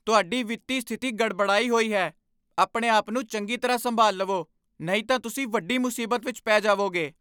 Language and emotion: Punjabi, angry